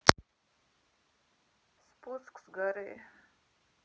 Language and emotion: Russian, sad